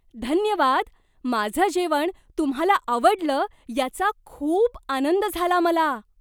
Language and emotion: Marathi, surprised